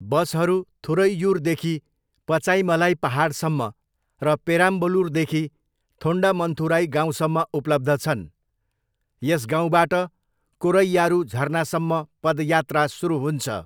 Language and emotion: Nepali, neutral